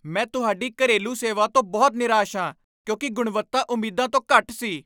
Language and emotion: Punjabi, angry